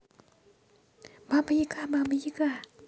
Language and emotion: Russian, positive